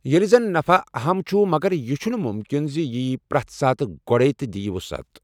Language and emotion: Kashmiri, neutral